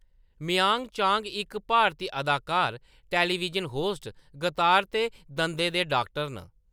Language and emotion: Dogri, neutral